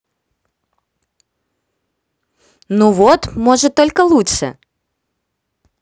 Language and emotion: Russian, positive